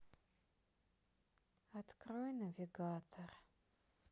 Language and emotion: Russian, sad